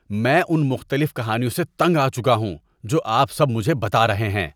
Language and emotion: Urdu, disgusted